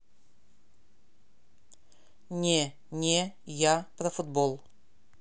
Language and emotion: Russian, neutral